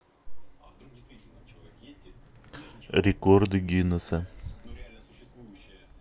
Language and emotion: Russian, neutral